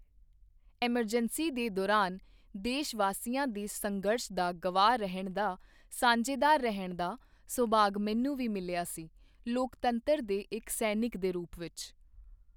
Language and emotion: Punjabi, neutral